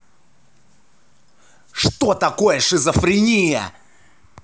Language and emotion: Russian, angry